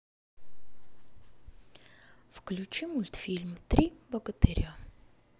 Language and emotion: Russian, sad